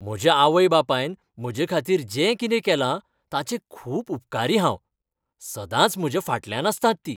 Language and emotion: Goan Konkani, happy